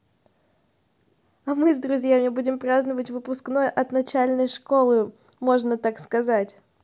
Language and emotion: Russian, positive